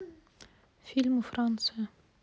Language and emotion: Russian, neutral